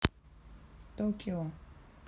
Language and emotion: Russian, neutral